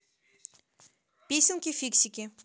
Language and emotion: Russian, positive